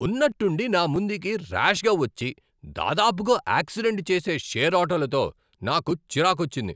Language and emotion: Telugu, angry